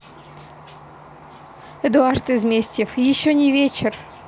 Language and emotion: Russian, neutral